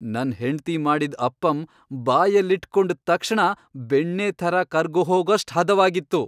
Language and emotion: Kannada, happy